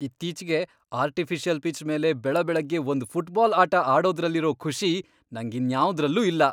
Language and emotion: Kannada, happy